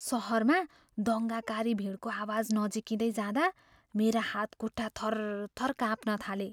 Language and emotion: Nepali, fearful